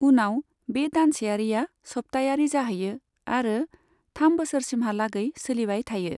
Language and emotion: Bodo, neutral